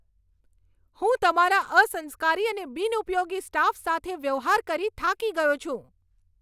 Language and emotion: Gujarati, angry